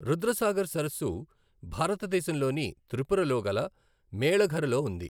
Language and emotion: Telugu, neutral